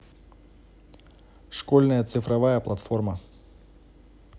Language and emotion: Russian, neutral